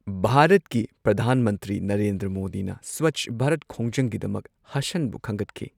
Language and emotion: Manipuri, neutral